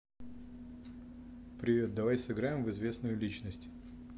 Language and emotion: Russian, neutral